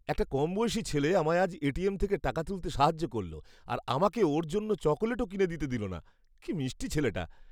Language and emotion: Bengali, happy